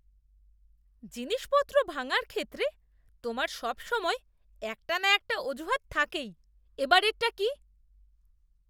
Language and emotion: Bengali, disgusted